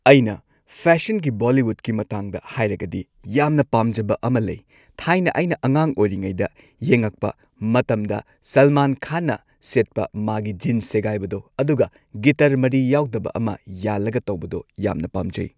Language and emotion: Manipuri, neutral